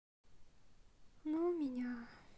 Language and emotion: Russian, sad